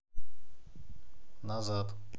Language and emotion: Russian, neutral